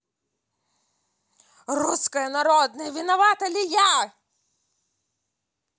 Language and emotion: Russian, neutral